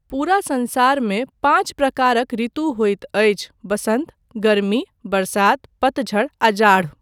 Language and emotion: Maithili, neutral